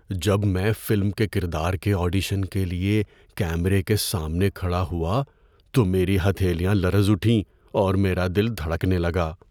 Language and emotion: Urdu, fearful